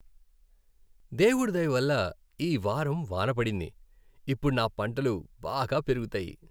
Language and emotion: Telugu, happy